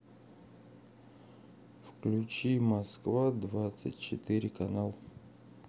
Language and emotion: Russian, neutral